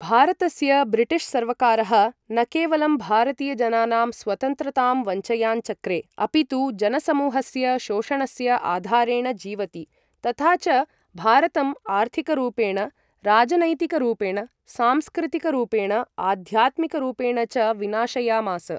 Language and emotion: Sanskrit, neutral